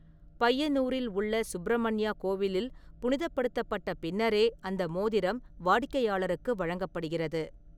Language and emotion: Tamil, neutral